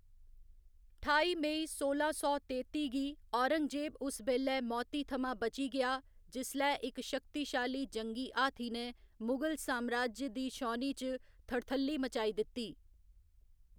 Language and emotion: Dogri, neutral